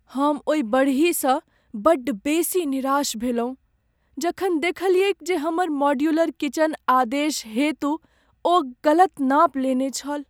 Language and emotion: Maithili, sad